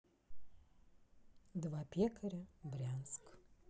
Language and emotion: Russian, neutral